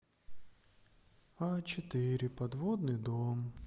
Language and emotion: Russian, sad